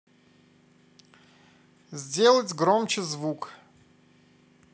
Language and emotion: Russian, positive